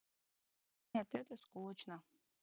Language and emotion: Russian, sad